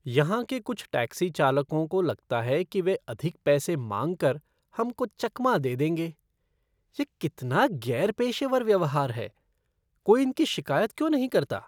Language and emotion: Hindi, disgusted